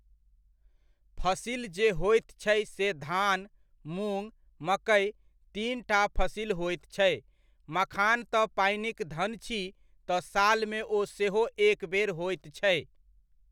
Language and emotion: Maithili, neutral